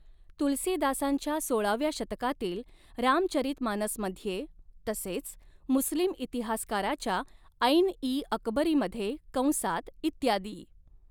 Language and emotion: Marathi, neutral